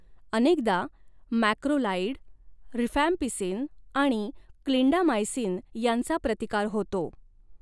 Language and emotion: Marathi, neutral